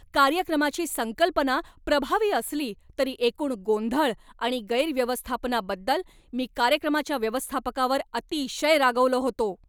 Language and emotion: Marathi, angry